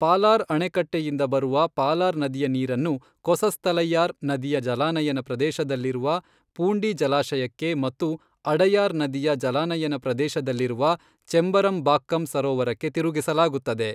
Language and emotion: Kannada, neutral